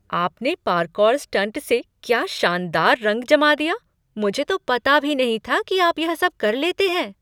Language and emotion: Hindi, surprised